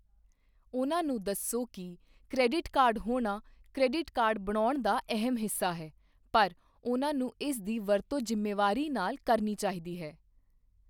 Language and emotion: Punjabi, neutral